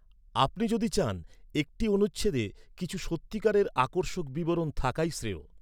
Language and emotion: Bengali, neutral